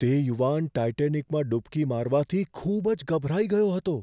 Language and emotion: Gujarati, fearful